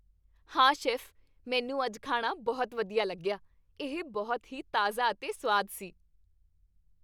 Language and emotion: Punjabi, happy